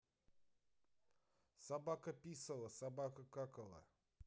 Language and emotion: Russian, neutral